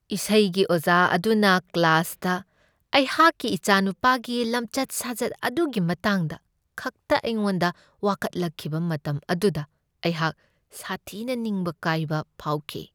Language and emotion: Manipuri, sad